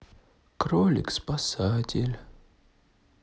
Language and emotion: Russian, sad